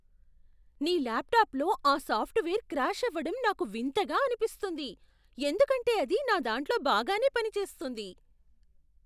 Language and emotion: Telugu, surprised